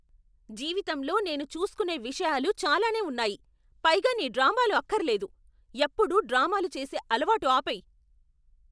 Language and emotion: Telugu, angry